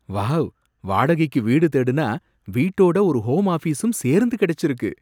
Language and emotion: Tamil, surprised